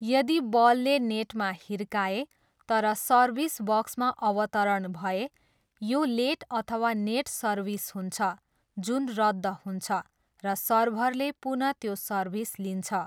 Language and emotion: Nepali, neutral